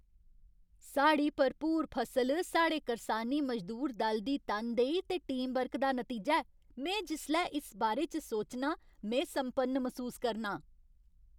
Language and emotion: Dogri, happy